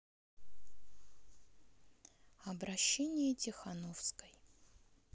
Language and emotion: Russian, neutral